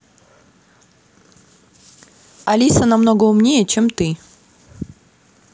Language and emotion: Russian, angry